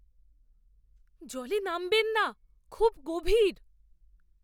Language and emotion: Bengali, fearful